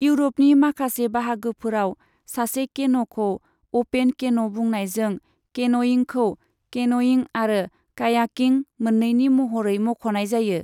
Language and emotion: Bodo, neutral